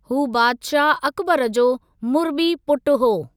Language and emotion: Sindhi, neutral